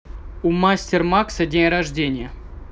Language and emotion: Russian, neutral